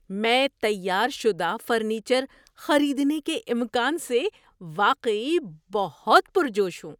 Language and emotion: Urdu, surprised